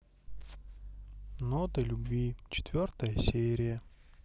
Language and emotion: Russian, neutral